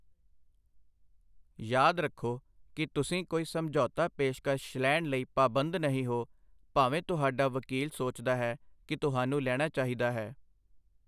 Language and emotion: Punjabi, neutral